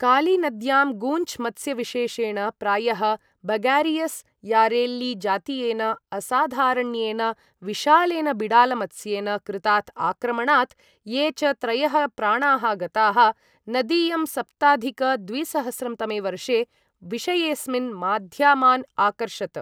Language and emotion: Sanskrit, neutral